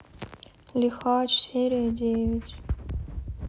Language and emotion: Russian, sad